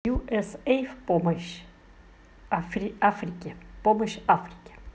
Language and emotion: Russian, neutral